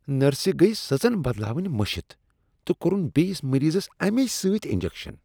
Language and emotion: Kashmiri, disgusted